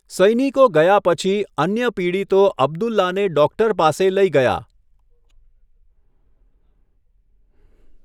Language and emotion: Gujarati, neutral